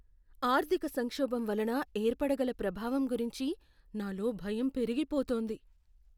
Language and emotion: Telugu, fearful